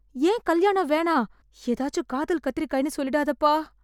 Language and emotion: Tamil, fearful